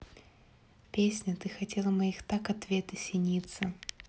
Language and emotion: Russian, neutral